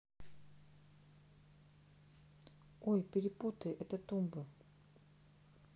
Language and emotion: Russian, neutral